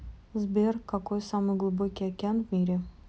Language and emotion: Russian, neutral